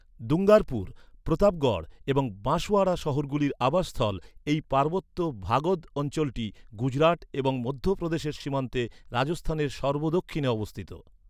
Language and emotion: Bengali, neutral